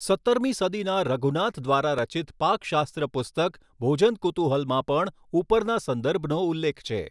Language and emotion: Gujarati, neutral